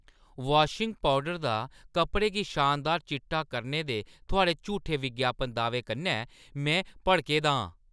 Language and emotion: Dogri, angry